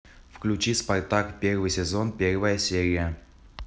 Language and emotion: Russian, neutral